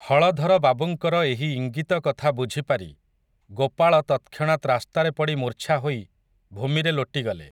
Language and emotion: Odia, neutral